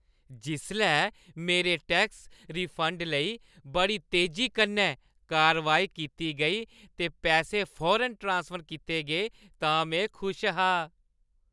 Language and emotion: Dogri, happy